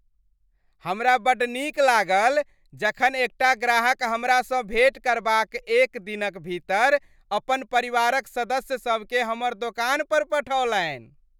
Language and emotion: Maithili, happy